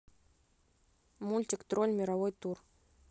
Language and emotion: Russian, neutral